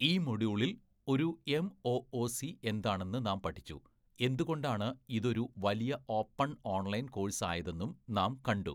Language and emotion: Malayalam, neutral